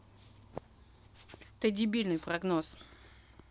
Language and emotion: Russian, angry